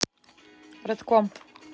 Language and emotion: Russian, neutral